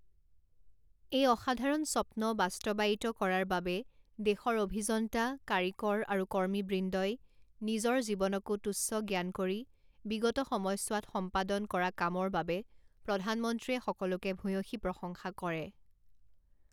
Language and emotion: Assamese, neutral